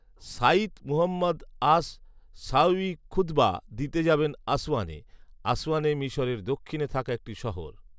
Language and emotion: Bengali, neutral